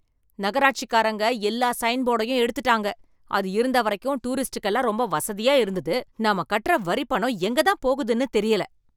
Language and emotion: Tamil, angry